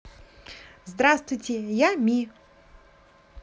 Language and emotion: Russian, positive